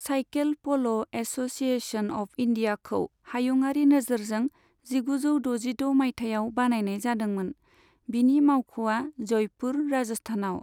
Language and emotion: Bodo, neutral